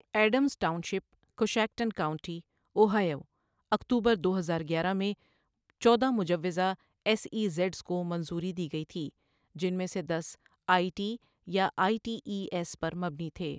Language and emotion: Urdu, neutral